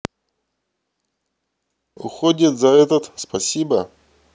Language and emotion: Russian, neutral